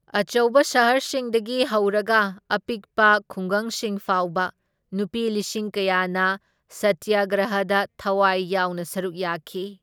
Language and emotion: Manipuri, neutral